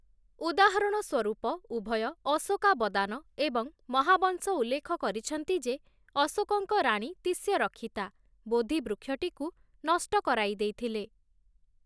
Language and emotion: Odia, neutral